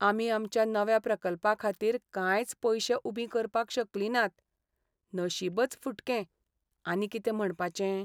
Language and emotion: Goan Konkani, sad